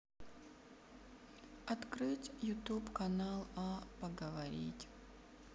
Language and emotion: Russian, sad